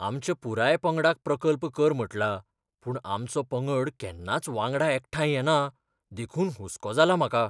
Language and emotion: Goan Konkani, fearful